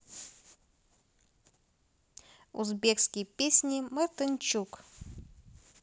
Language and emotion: Russian, neutral